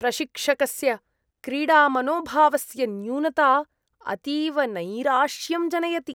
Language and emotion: Sanskrit, disgusted